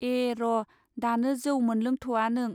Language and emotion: Bodo, neutral